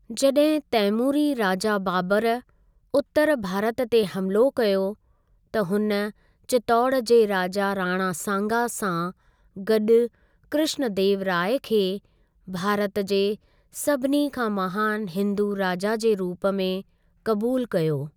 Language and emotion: Sindhi, neutral